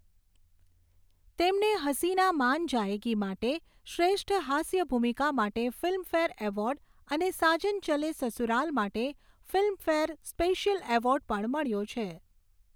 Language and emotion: Gujarati, neutral